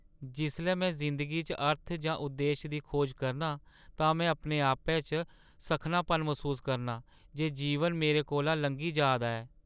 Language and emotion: Dogri, sad